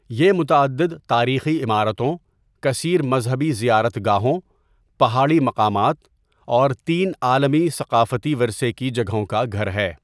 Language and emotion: Urdu, neutral